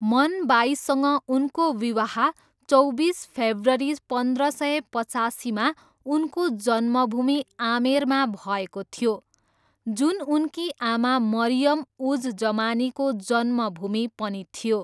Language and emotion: Nepali, neutral